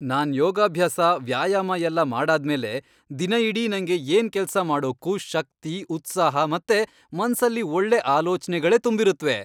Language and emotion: Kannada, happy